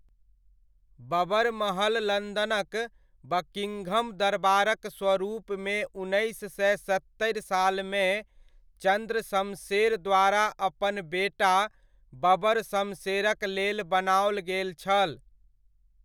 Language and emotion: Maithili, neutral